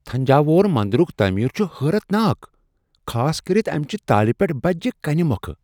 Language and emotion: Kashmiri, surprised